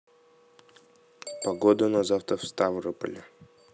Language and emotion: Russian, neutral